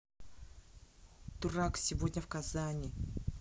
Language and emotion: Russian, angry